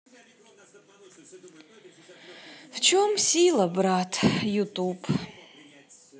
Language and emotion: Russian, sad